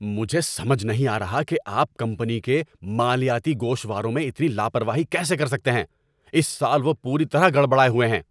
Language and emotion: Urdu, angry